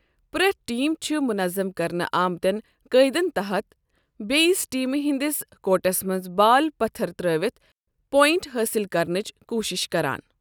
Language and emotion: Kashmiri, neutral